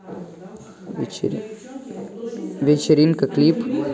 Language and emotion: Russian, neutral